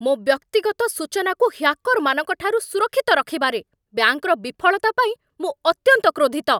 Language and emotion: Odia, angry